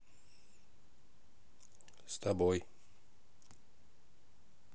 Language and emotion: Russian, neutral